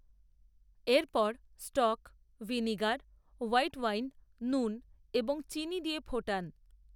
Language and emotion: Bengali, neutral